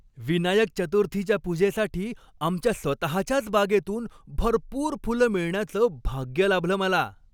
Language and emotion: Marathi, happy